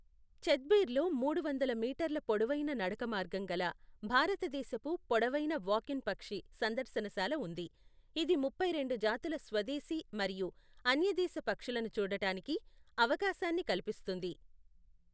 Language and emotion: Telugu, neutral